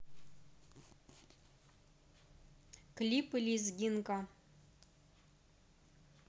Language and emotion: Russian, neutral